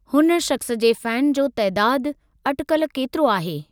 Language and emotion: Sindhi, neutral